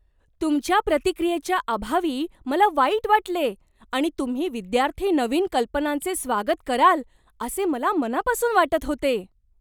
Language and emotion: Marathi, surprised